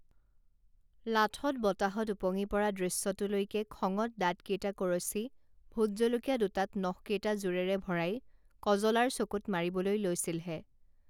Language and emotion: Assamese, neutral